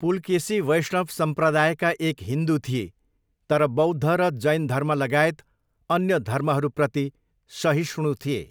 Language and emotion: Nepali, neutral